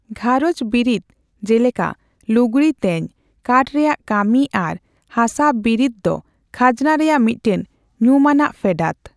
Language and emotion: Santali, neutral